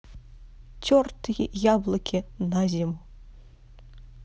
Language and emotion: Russian, neutral